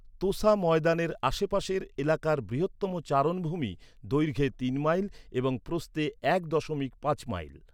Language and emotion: Bengali, neutral